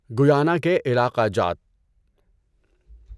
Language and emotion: Urdu, neutral